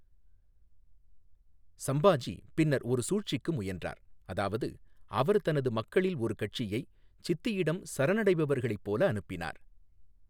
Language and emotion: Tamil, neutral